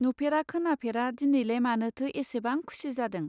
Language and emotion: Bodo, neutral